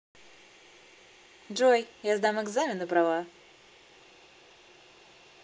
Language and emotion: Russian, positive